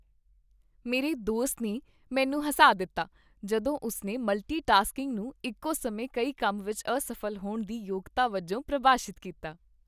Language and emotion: Punjabi, happy